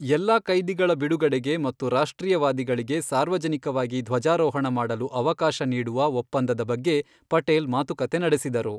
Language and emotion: Kannada, neutral